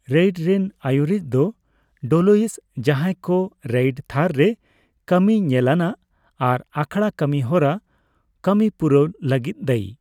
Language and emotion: Santali, neutral